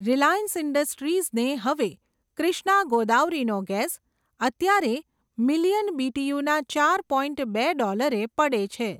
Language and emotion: Gujarati, neutral